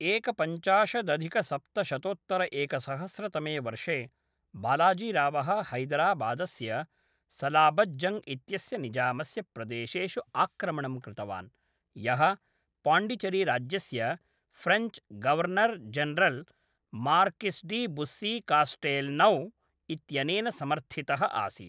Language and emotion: Sanskrit, neutral